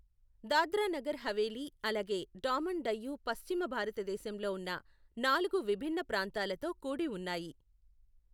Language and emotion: Telugu, neutral